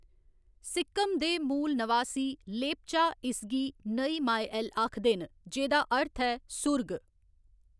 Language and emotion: Dogri, neutral